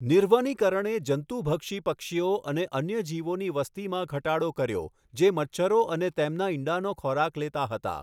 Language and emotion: Gujarati, neutral